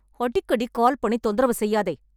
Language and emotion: Tamil, angry